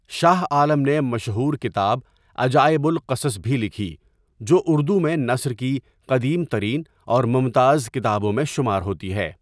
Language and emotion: Urdu, neutral